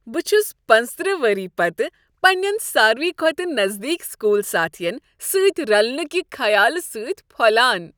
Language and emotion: Kashmiri, happy